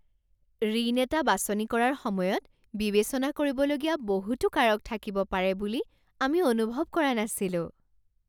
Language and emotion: Assamese, surprised